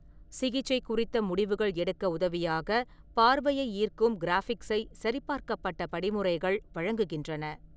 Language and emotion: Tamil, neutral